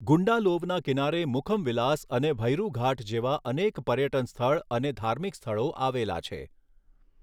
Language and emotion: Gujarati, neutral